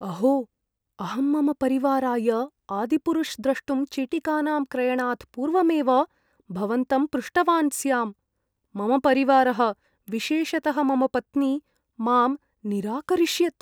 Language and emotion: Sanskrit, fearful